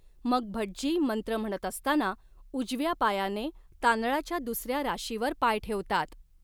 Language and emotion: Marathi, neutral